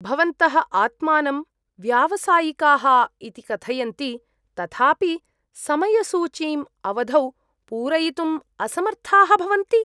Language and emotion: Sanskrit, disgusted